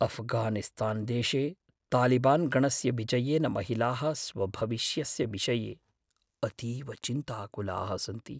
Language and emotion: Sanskrit, fearful